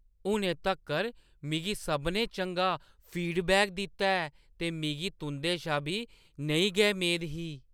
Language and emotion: Dogri, surprised